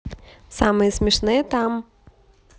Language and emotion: Russian, positive